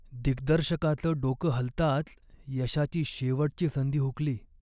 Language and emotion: Marathi, sad